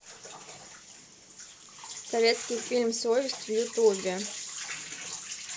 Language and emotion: Russian, neutral